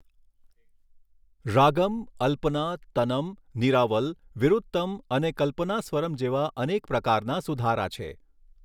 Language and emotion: Gujarati, neutral